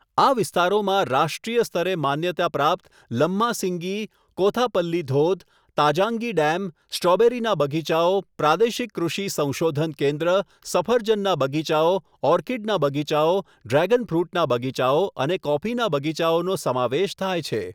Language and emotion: Gujarati, neutral